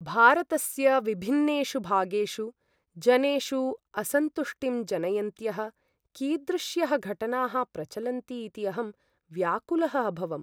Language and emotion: Sanskrit, sad